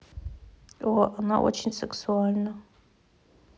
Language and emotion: Russian, neutral